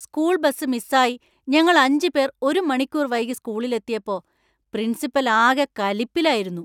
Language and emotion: Malayalam, angry